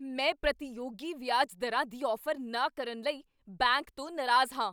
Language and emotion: Punjabi, angry